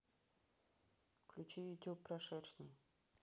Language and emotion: Russian, neutral